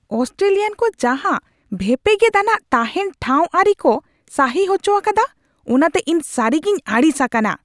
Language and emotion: Santali, angry